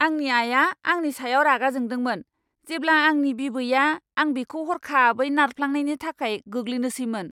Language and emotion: Bodo, angry